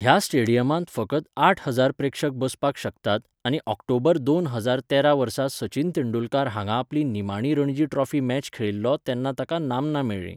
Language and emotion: Goan Konkani, neutral